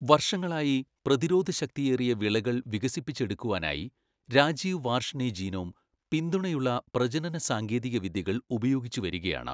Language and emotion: Malayalam, neutral